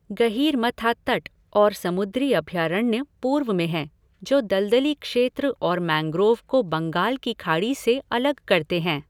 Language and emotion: Hindi, neutral